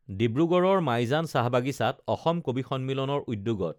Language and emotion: Assamese, neutral